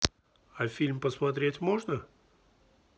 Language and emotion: Russian, neutral